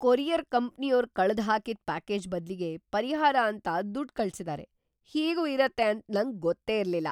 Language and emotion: Kannada, surprised